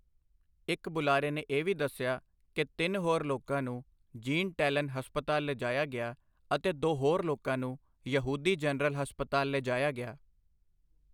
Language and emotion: Punjabi, neutral